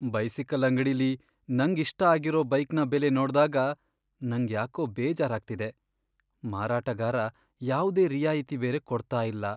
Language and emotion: Kannada, sad